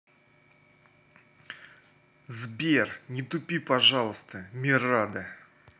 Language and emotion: Russian, angry